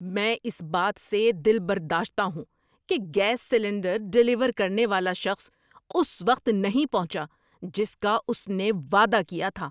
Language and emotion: Urdu, angry